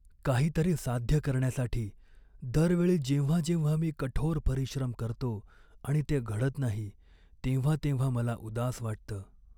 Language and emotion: Marathi, sad